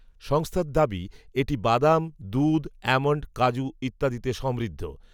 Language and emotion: Bengali, neutral